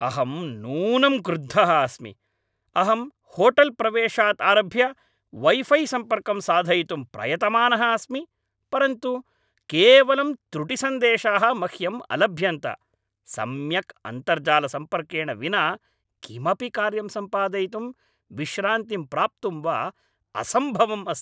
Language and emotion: Sanskrit, angry